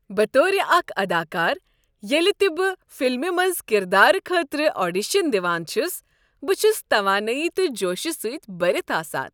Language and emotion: Kashmiri, happy